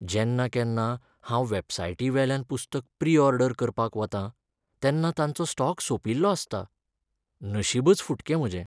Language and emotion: Goan Konkani, sad